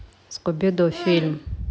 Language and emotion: Russian, neutral